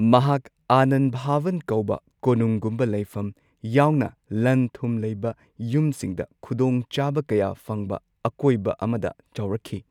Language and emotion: Manipuri, neutral